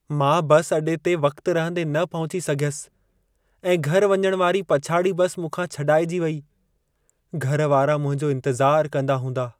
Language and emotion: Sindhi, sad